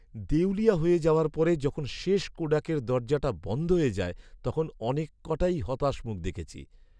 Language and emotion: Bengali, sad